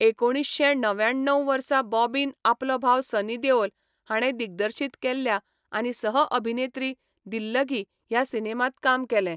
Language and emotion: Goan Konkani, neutral